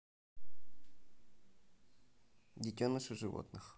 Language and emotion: Russian, neutral